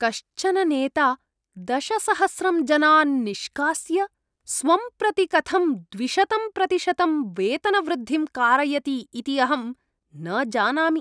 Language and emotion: Sanskrit, disgusted